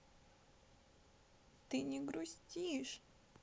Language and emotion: Russian, sad